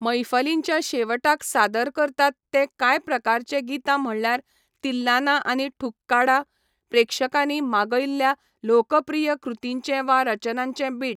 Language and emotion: Goan Konkani, neutral